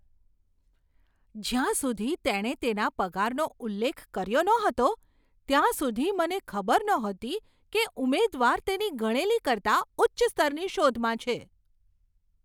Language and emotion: Gujarati, surprised